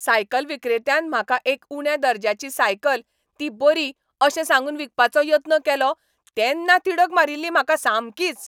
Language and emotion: Goan Konkani, angry